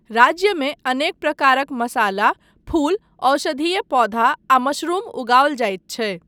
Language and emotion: Maithili, neutral